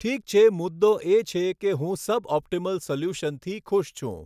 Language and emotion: Gujarati, neutral